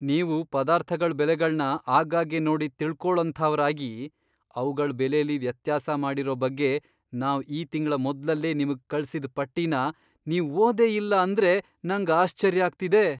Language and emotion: Kannada, surprised